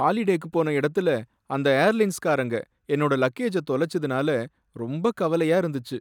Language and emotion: Tamil, sad